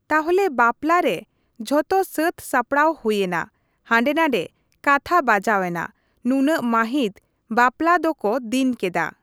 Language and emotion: Santali, neutral